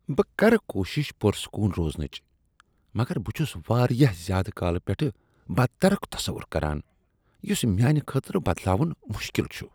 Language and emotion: Kashmiri, disgusted